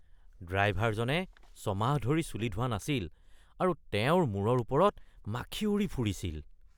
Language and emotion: Assamese, disgusted